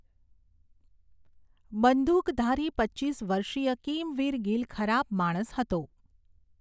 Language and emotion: Gujarati, neutral